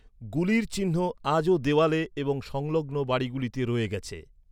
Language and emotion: Bengali, neutral